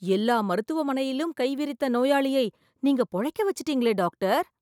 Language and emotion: Tamil, surprised